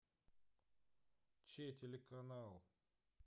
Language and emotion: Russian, neutral